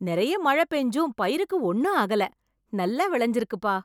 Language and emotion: Tamil, surprised